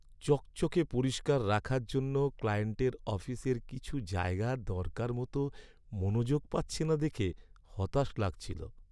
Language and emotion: Bengali, sad